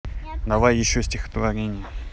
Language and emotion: Russian, neutral